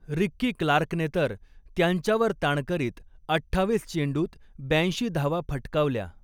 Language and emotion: Marathi, neutral